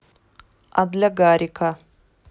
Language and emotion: Russian, neutral